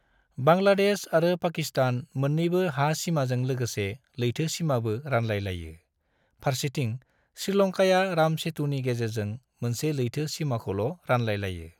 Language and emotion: Bodo, neutral